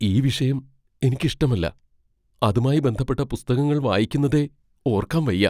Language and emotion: Malayalam, fearful